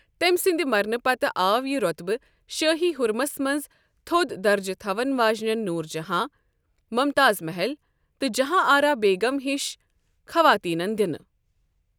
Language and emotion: Kashmiri, neutral